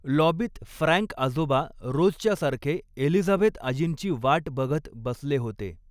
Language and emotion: Marathi, neutral